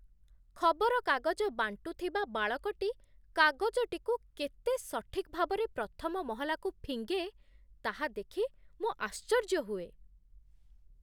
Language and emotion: Odia, surprised